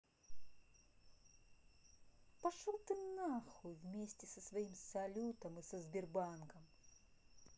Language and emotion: Russian, angry